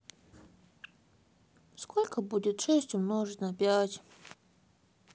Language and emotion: Russian, sad